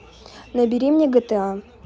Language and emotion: Russian, neutral